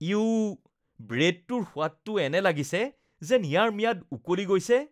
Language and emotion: Assamese, disgusted